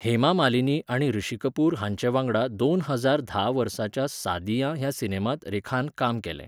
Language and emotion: Goan Konkani, neutral